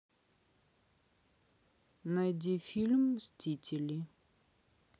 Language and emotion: Russian, neutral